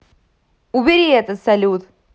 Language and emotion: Russian, angry